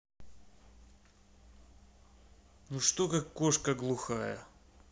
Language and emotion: Russian, angry